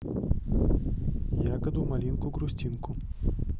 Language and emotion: Russian, neutral